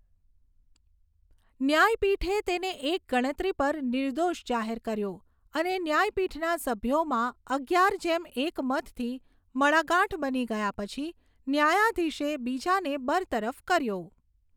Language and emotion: Gujarati, neutral